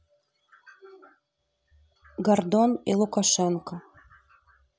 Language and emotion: Russian, neutral